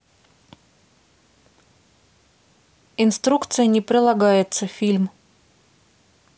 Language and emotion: Russian, neutral